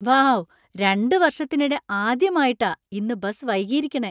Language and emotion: Malayalam, surprised